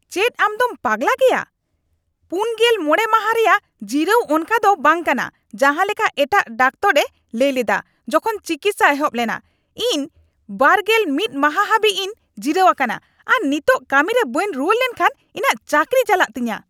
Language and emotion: Santali, angry